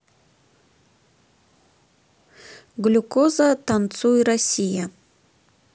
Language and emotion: Russian, neutral